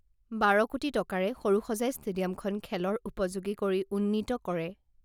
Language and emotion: Assamese, neutral